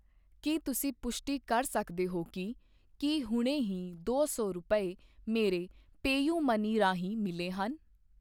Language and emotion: Punjabi, neutral